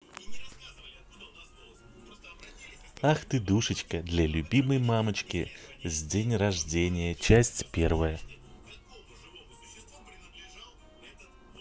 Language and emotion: Russian, positive